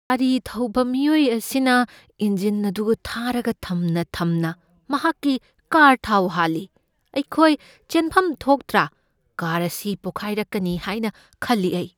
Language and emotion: Manipuri, fearful